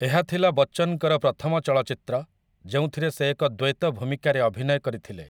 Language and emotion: Odia, neutral